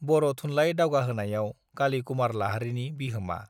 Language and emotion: Bodo, neutral